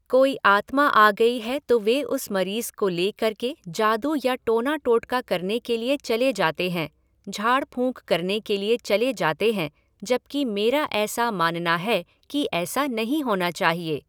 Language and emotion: Hindi, neutral